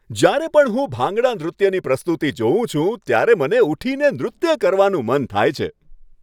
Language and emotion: Gujarati, happy